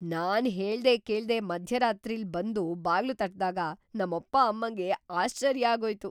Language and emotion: Kannada, surprised